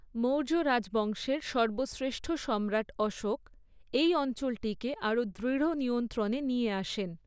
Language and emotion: Bengali, neutral